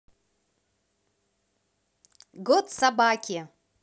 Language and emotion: Russian, positive